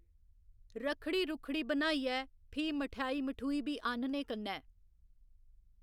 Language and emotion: Dogri, neutral